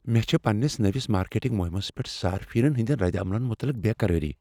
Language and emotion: Kashmiri, fearful